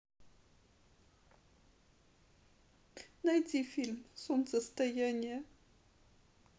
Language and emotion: Russian, sad